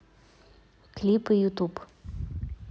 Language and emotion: Russian, neutral